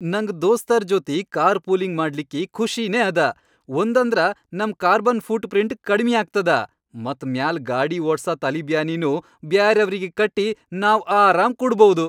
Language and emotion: Kannada, happy